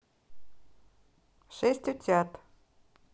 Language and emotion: Russian, neutral